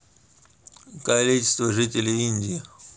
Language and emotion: Russian, neutral